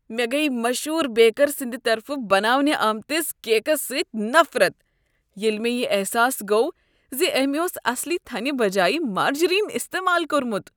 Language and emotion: Kashmiri, disgusted